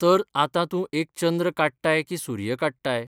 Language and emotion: Goan Konkani, neutral